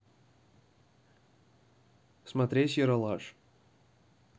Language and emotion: Russian, neutral